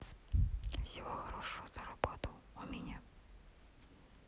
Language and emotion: Russian, neutral